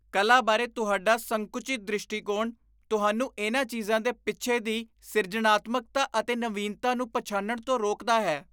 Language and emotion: Punjabi, disgusted